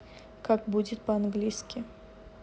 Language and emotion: Russian, neutral